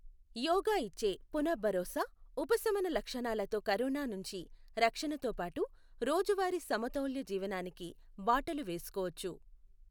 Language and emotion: Telugu, neutral